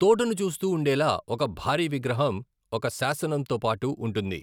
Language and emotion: Telugu, neutral